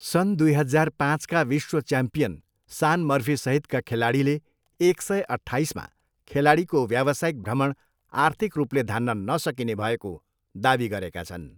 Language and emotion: Nepali, neutral